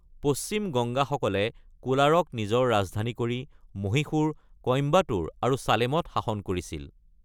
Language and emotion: Assamese, neutral